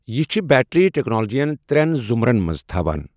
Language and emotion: Kashmiri, neutral